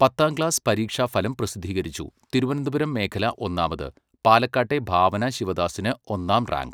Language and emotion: Malayalam, neutral